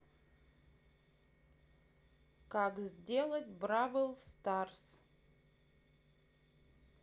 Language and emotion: Russian, neutral